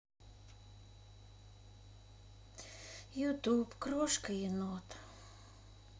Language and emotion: Russian, sad